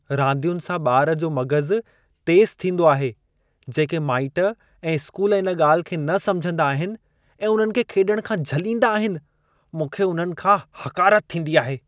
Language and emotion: Sindhi, disgusted